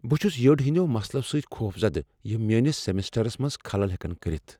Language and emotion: Kashmiri, fearful